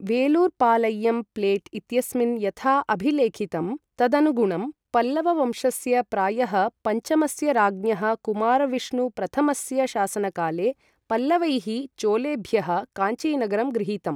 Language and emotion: Sanskrit, neutral